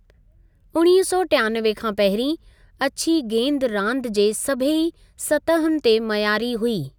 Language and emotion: Sindhi, neutral